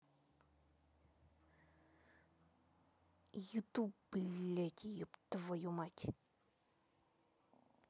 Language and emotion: Russian, angry